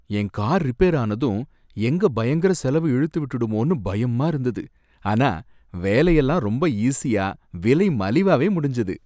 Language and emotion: Tamil, happy